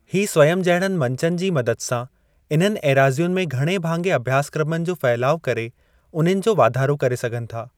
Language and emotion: Sindhi, neutral